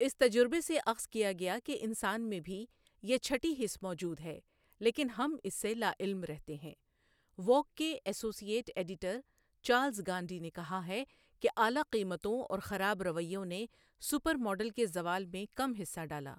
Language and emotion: Urdu, neutral